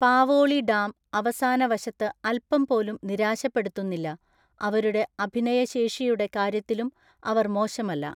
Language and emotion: Malayalam, neutral